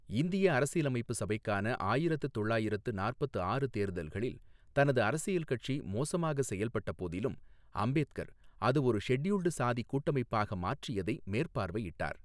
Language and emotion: Tamil, neutral